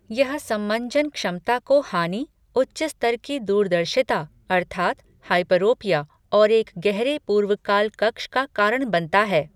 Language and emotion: Hindi, neutral